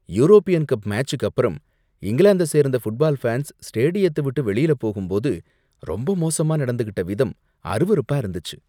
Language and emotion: Tamil, disgusted